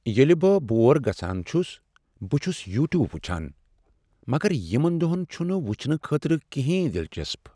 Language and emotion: Kashmiri, sad